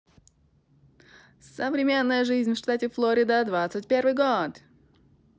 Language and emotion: Russian, positive